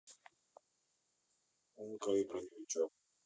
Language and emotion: Russian, neutral